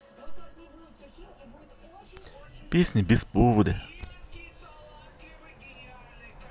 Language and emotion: Russian, neutral